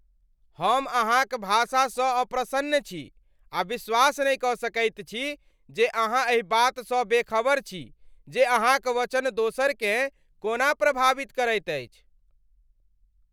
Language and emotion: Maithili, angry